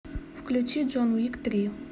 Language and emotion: Russian, neutral